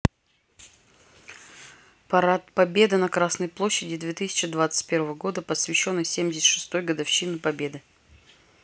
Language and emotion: Russian, neutral